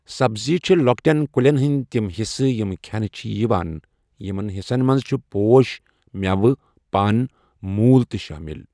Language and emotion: Kashmiri, neutral